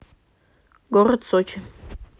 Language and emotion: Russian, neutral